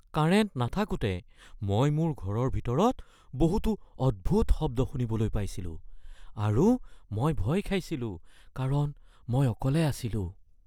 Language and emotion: Assamese, fearful